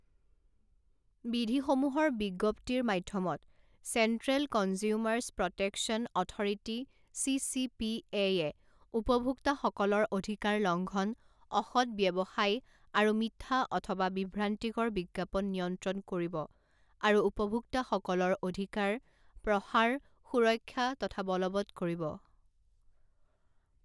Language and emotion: Assamese, neutral